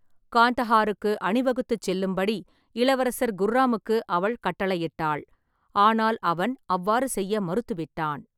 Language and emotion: Tamil, neutral